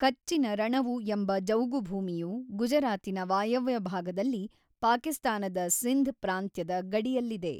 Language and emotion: Kannada, neutral